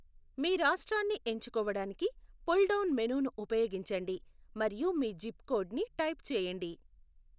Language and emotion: Telugu, neutral